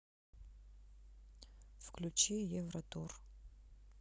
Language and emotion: Russian, neutral